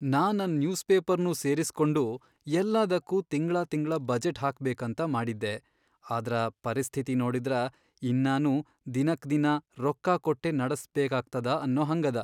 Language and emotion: Kannada, sad